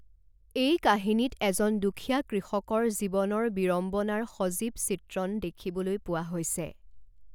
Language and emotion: Assamese, neutral